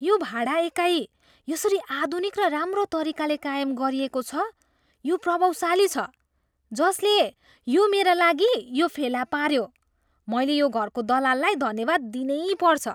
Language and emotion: Nepali, surprised